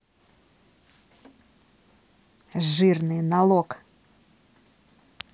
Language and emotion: Russian, angry